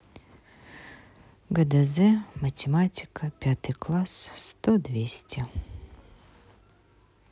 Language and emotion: Russian, sad